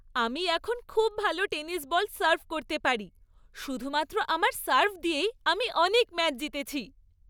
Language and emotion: Bengali, happy